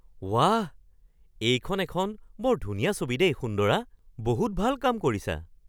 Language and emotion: Assamese, surprised